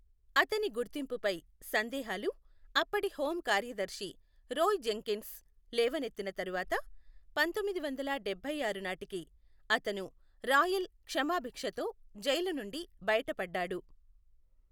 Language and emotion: Telugu, neutral